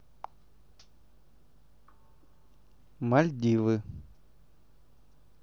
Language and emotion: Russian, neutral